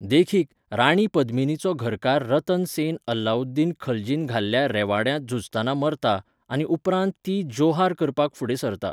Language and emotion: Goan Konkani, neutral